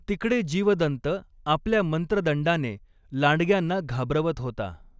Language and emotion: Marathi, neutral